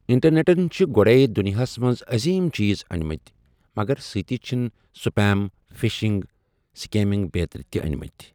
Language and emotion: Kashmiri, neutral